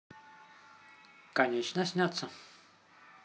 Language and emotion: Russian, positive